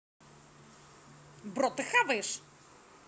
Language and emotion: Russian, angry